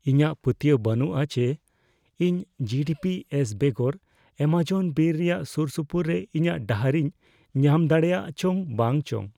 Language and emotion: Santali, fearful